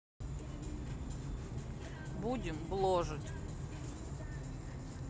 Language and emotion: Russian, neutral